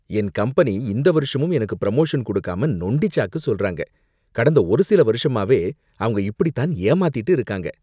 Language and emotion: Tamil, disgusted